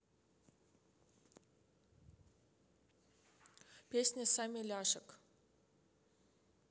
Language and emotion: Russian, neutral